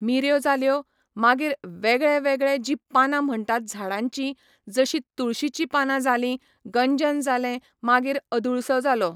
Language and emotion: Goan Konkani, neutral